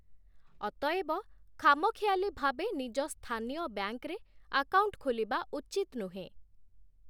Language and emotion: Odia, neutral